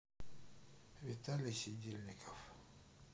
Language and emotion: Russian, sad